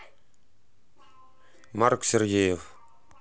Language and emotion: Russian, neutral